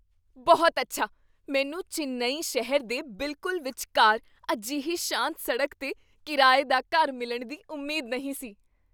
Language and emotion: Punjabi, surprised